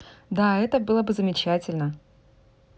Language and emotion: Russian, positive